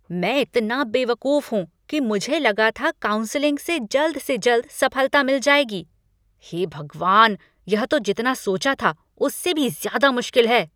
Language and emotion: Hindi, angry